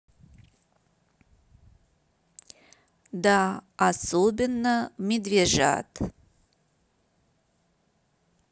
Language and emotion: Russian, neutral